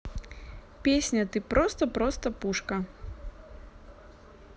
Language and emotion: Russian, neutral